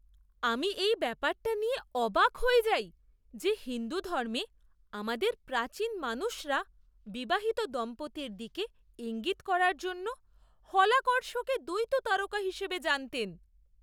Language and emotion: Bengali, surprised